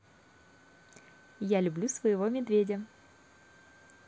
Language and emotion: Russian, positive